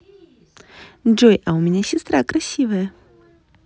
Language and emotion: Russian, positive